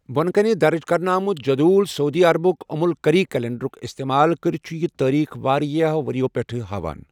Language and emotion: Kashmiri, neutral